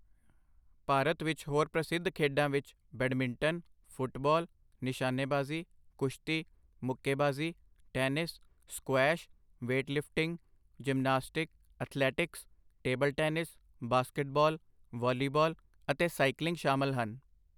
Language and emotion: Punjabi, neutral